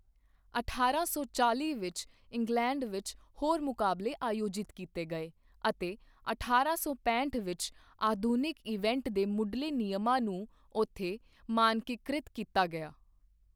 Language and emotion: Punjabi, neutral